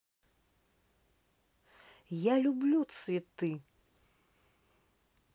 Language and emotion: Russian, neutral